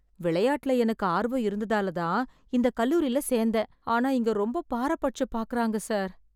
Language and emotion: Tamil, sad